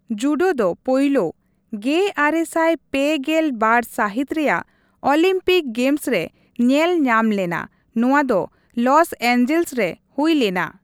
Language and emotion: Santali, neutral